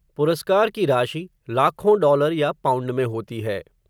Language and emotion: Hindi, neutral